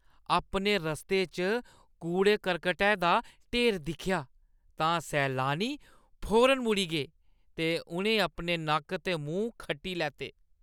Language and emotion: Dogri, disgusted